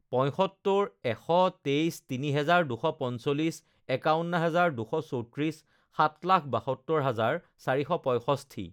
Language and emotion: Assamese, neutral